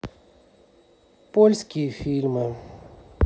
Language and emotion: Russian, sad